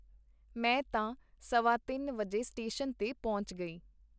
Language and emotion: Punjabi, neutral